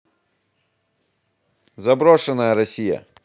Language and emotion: Russian, neutral